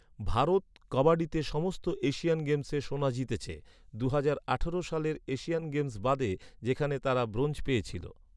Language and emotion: Bengali, neutral